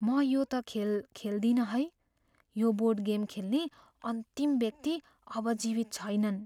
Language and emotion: Nepali, fearful